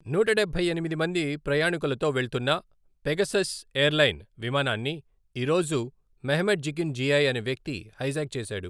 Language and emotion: Telugu, neutral